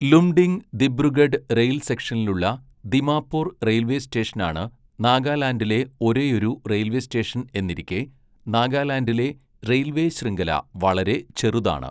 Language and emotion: Malayalam, neutral